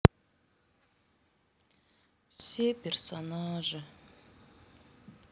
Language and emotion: Russian, sad